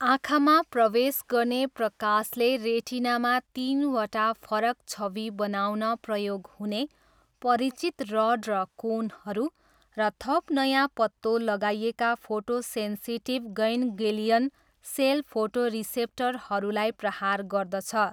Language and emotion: Nepali, neutral